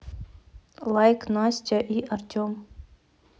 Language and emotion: Russian, neutral